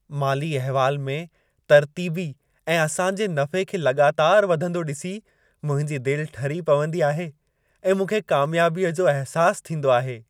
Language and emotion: Sindhi, happy